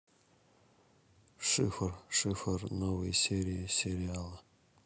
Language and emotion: Russian, neutral